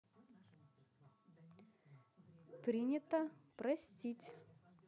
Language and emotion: Russian, positive